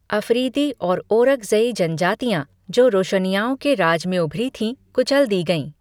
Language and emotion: Hindi, neutral